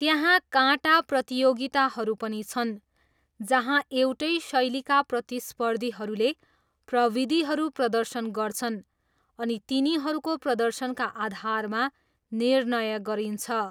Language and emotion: Nepali, neutral